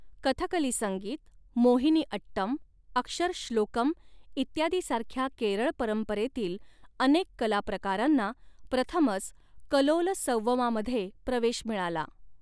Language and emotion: Marathi, neutral